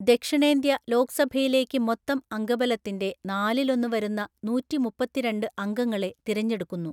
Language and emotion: Malayalam, neutral